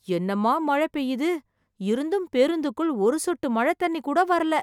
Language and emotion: Tamil, surprised